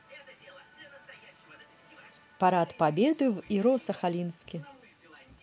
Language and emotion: Russian, positive